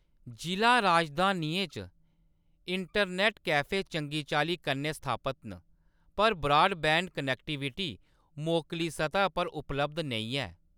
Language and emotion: Dogri, neutral